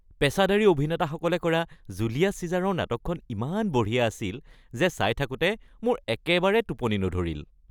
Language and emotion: Assamese, happy